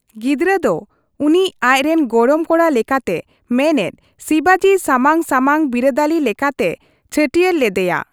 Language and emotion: Santali, neutral